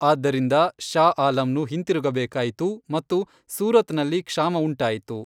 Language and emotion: Kannada, neutral